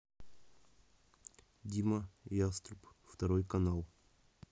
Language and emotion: Russian, neutral